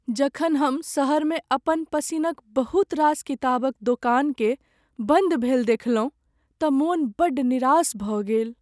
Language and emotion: Maithili, sad